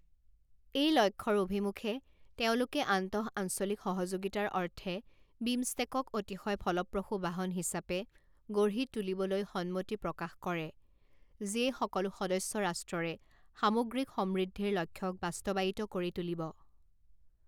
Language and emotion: Assamese, neutral